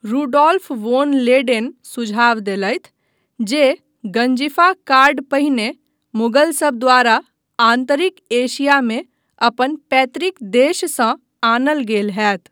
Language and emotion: Maithili, neutral